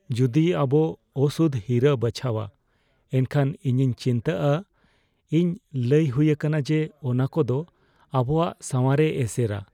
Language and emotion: Santali, fearful